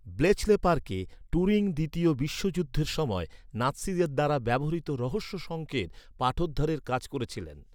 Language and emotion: Bengali, neutral